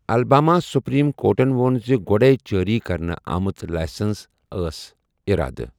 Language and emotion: Kashmiri, neutral